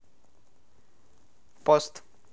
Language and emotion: Russian, neutral